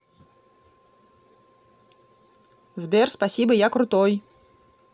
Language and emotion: Russian, positive